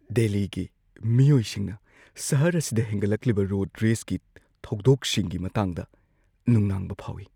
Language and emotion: Manipuri, fearful